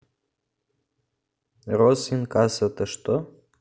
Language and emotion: Russian, neutral